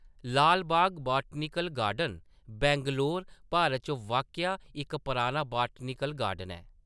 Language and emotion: Dogri, neutral